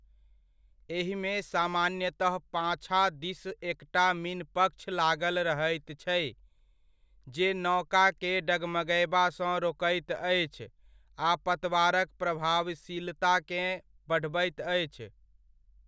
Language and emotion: Maithili, neutral